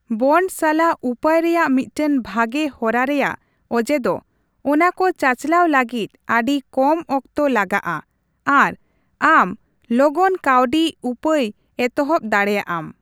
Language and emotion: Santali, neutral